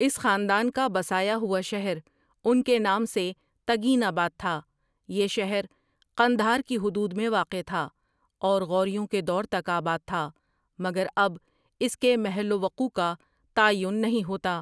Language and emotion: Urdu, neutral